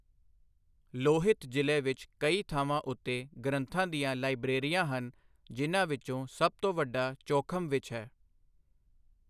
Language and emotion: Punjabi, neutral